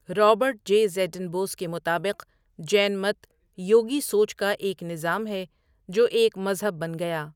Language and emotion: Urdu, neutral